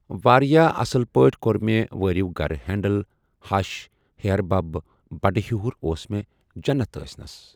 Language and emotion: Kashmiri, neutral